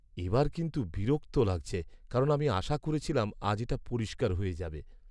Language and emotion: Bengali, sad